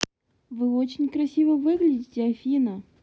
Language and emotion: Russian, positive